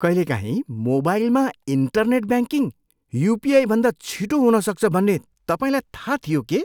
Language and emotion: Nepali, surprised